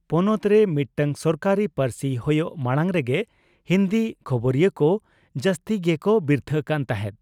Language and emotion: Santali, neutral